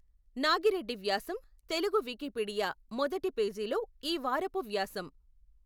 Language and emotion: Telugu, neutral